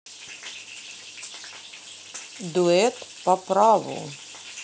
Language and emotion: Russian, neutral